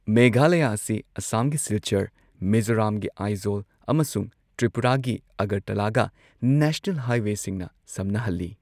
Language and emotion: Manipuri, neutral